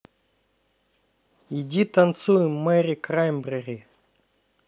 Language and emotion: Russian, neutral